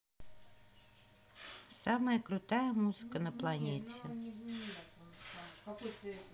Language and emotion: Russian, neutral